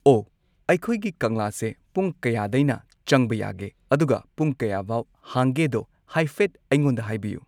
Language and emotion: Manipuri, neutral